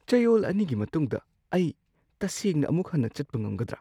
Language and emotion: Manipuri, surprised